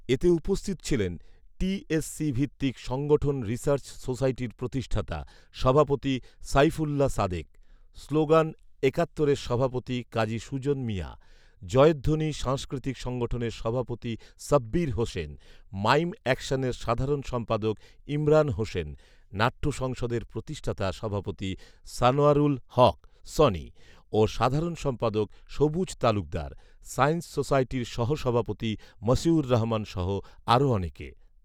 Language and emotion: Bengali, neutral